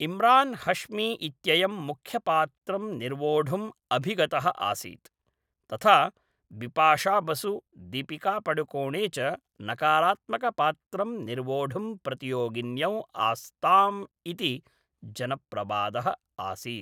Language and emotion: Sanskrit, neutral